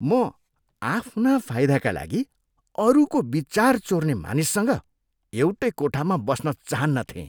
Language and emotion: Nepali, disgusted